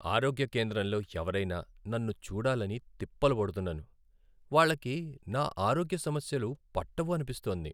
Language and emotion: Telugu, sad